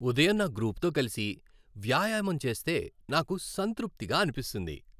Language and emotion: Telugu, happy